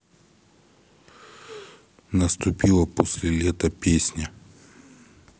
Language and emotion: Russian, neutral